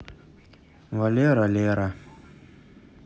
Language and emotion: Russian, neutral